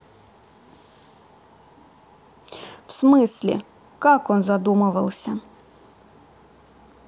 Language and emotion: Russian, neutral